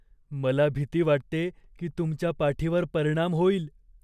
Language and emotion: Marathi, fearful